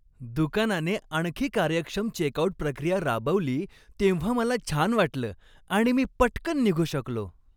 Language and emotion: Marathi, happy